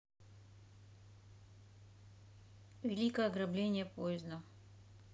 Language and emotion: Russian, neutral